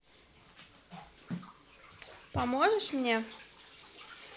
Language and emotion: Russian, neutral